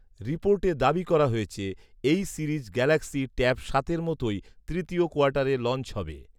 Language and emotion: Bengali, neutral